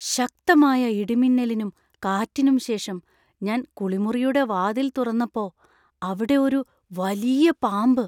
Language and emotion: Malayalam, fearful